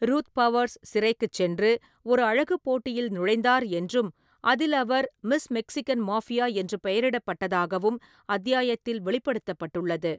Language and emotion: Tamil, neutral